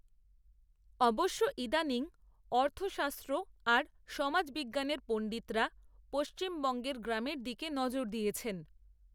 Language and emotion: Bengali, neutral